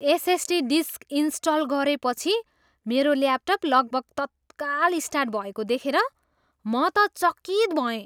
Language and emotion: Nepali, surprised